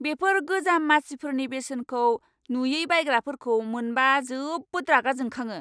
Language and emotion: Bodo, angry